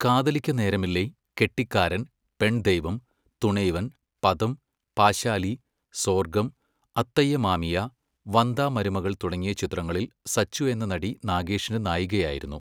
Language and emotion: Malayalam, neutral